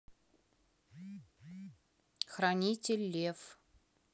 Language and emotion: Russian, neutral